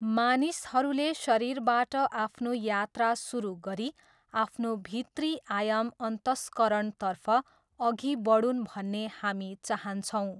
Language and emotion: Nepali, neutral